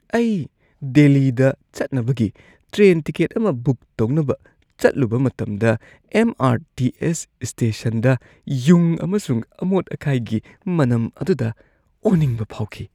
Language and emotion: Manipuri, disgusted